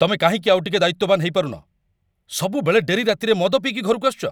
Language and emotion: Odia, angry